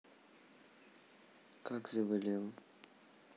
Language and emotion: Russian, sad